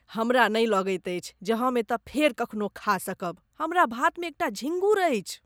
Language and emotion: Maithili, disgusted